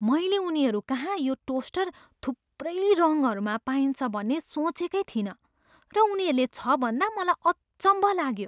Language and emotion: Nepali, surprised